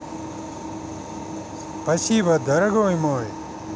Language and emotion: Russian, positive